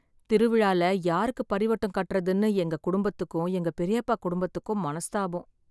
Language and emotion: Tamil, sad